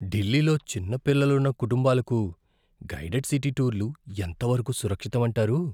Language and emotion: Telugu, fearful